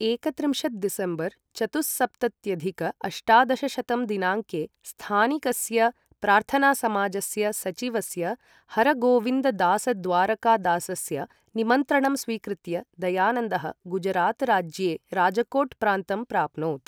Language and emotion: Sanskrit, neutral